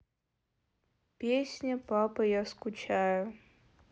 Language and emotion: Russian, sad